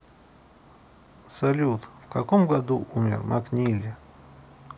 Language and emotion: Russian, neutral